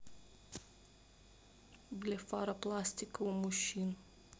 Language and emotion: Russian, neutral